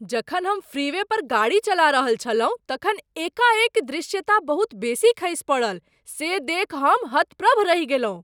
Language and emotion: Maithili, surprised